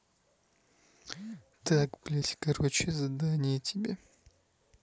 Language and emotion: Russian, angry